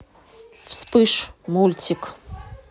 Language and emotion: Russian, neutral